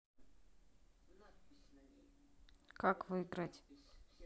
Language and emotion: Russian, neutral